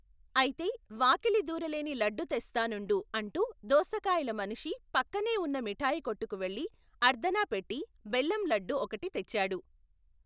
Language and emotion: Telugu, neutral